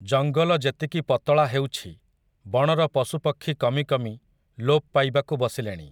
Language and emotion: Odia, neutral